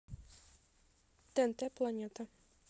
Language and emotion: Russian, neutral